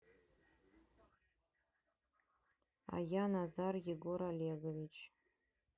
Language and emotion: Russian, neutral